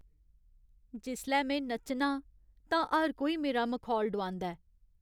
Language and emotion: Dogri, sad